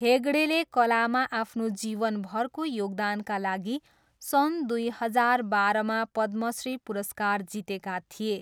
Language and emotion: Nepali, neutral